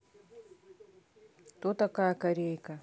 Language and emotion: Russian, neutral